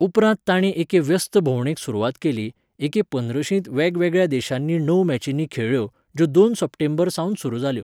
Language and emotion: Goan Konkani, neutral